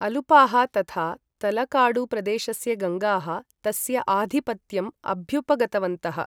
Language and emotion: Sanskrit, neutral